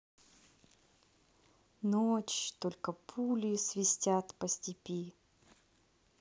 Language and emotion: Russian, neutral